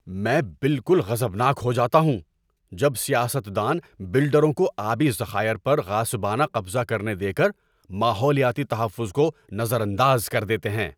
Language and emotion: Urdu, angry